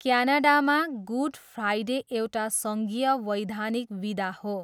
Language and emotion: Nepali, neutral